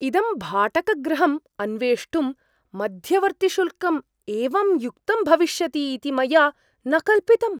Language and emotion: Sanskrit, surprised